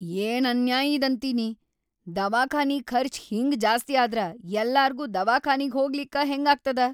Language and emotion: Kannada, angry